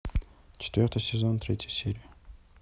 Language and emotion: Russian, neutral